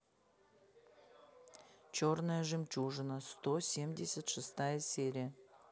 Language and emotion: Russian, neutral